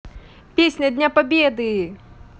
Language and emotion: Russian, positive